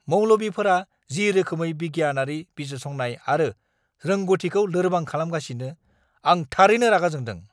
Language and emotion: Bodo, angry